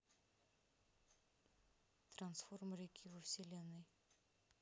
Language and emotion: Russian, neutral